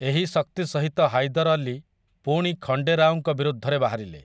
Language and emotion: Odia, neutral